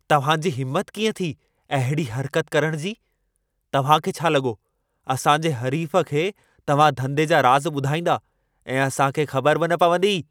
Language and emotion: Sindhi, angry